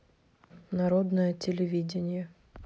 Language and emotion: Russian, neutral